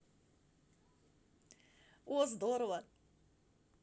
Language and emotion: Russian, positive